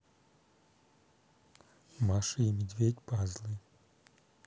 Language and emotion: Russian, neutral